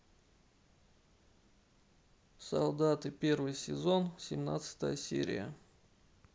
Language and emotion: Russian, neutral